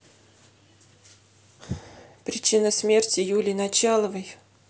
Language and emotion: Russian, sad